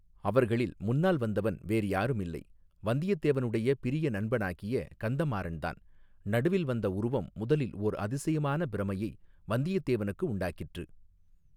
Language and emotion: Tamil, neutral